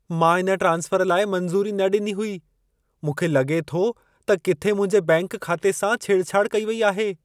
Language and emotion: Sindhi, fearful